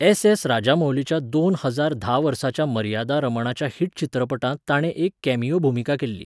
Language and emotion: Goan Konkani, neutral